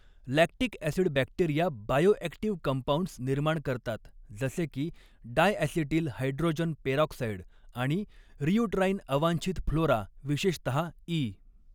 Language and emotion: Marathi, neutral